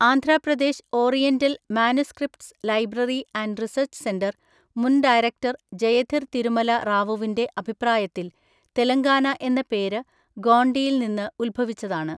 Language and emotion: Malayalam, neutral